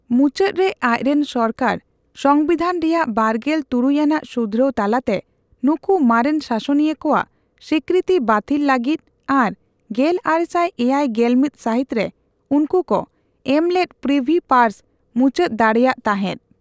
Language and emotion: Santali, neutral